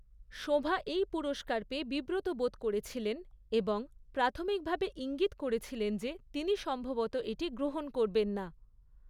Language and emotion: Bengali, neutral